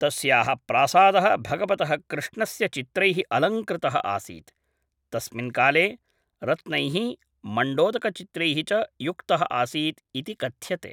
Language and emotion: Sanskrit, neutral